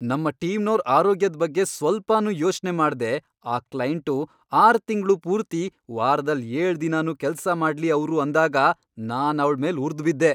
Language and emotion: Kannada, angry